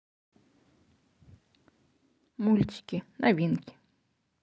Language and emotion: Russian, neutral